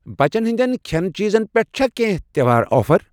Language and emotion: Kashmiri, neutral